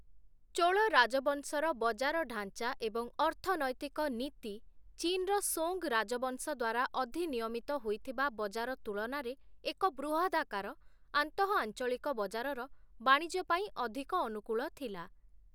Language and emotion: Odia, neutral